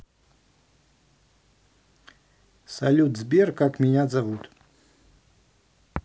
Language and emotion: Russian, neutral